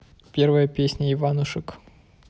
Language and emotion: Russian, neutral